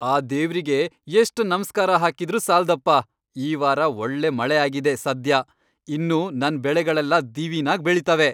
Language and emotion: Kannada, happy